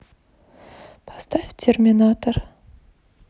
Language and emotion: Russian, sad